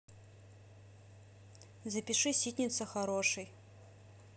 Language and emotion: Russian, neutral